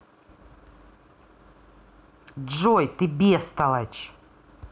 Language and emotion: Russian, angry